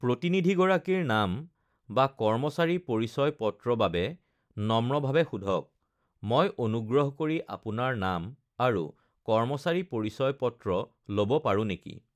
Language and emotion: Assamese, neutral